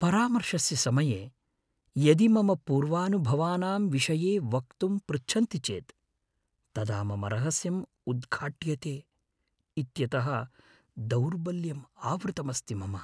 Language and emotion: Sanskrit, fearful